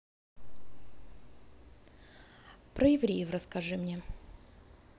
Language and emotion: Russian, neutral